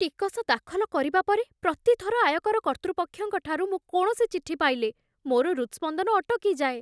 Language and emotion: Odia, fearful